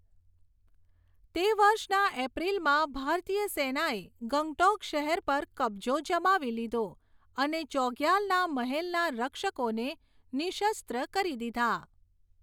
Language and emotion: Gujarati, neutral